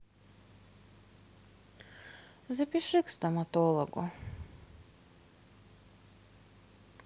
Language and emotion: Russian, sad